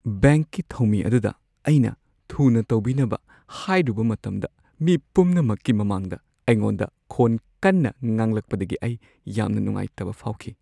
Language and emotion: Manipuri, sad